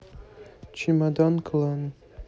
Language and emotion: Russian, neutral